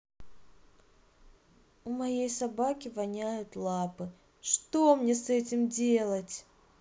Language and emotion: Russian, sad